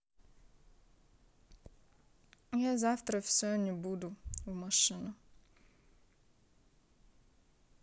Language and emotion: Russian, neutral